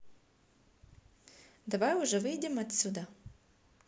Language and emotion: Russian, positive